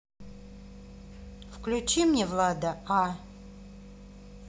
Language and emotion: Russian, neutral